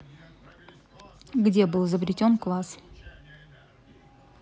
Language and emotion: Russian, neutral